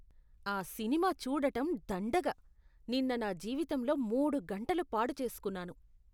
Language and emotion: Telugu, disgusted